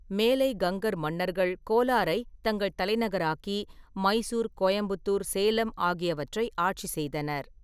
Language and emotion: Tamil, neutral